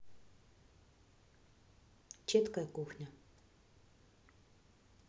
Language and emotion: Russian, neutral